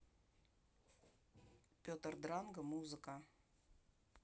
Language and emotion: Russian, neutral